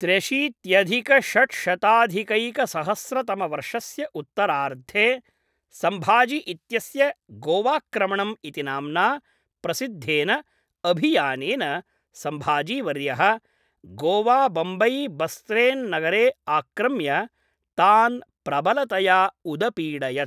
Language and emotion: Sanskrit, neutral